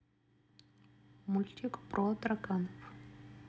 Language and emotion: Russian, neutral